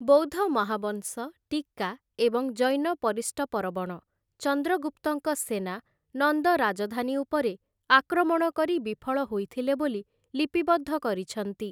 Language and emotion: Odia, neutral